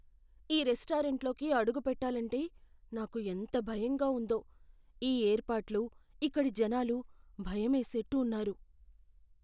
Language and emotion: Telugu, fearful